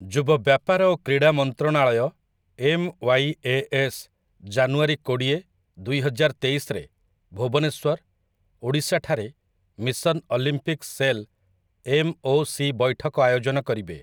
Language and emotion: Odia, neutral